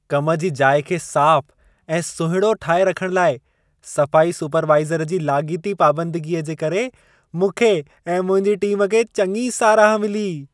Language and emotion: Sindhi, happy